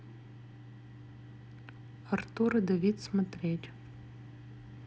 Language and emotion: Russian, neutral